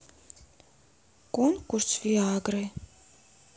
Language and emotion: Russian, neutral